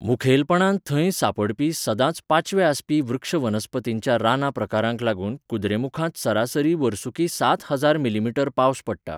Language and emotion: Goan Konkani, neutral